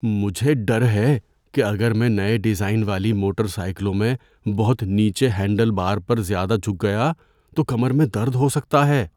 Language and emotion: Urdu, fearful